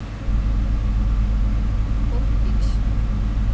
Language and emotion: Russian, neutral